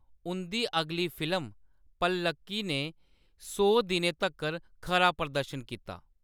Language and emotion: Dogri, neutral